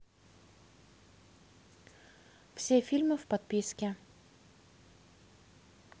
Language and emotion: Russian, neutral